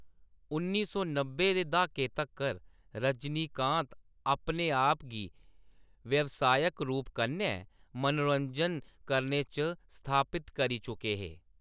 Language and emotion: Dogri, neutral